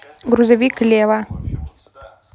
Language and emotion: Russian, neutral